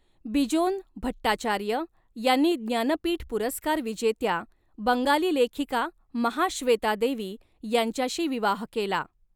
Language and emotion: Marathi, neutral